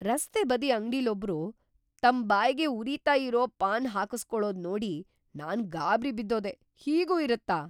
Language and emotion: Kannada, surprised